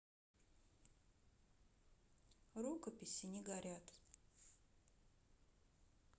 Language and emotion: Russian, neutral